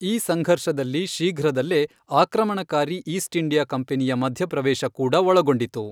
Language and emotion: Kannada, neutral